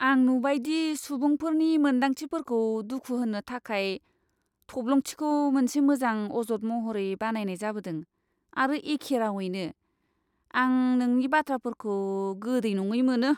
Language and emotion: Bodo, disgusted